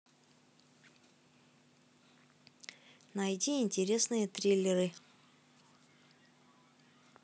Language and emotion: Russian, neutral